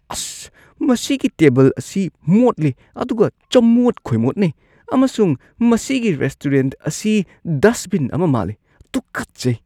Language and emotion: Manipuri, disgusted